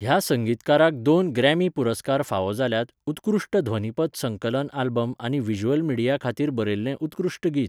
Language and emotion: Goan Konkani, neutral